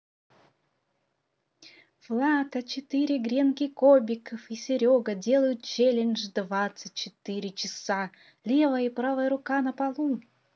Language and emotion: Russian, positive